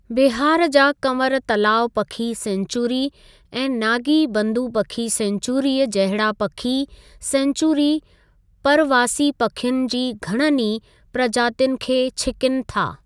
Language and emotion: Sindhi, neutral